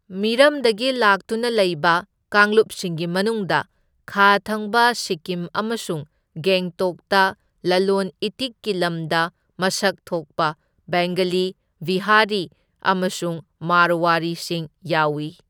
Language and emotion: Manipuri, neutral